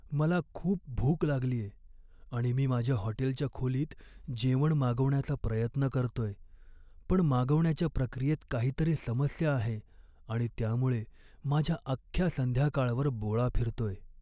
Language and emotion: Marathi, sad